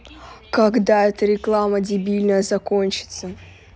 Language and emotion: Russian, angry